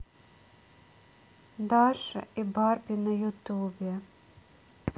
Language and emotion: Russian, sad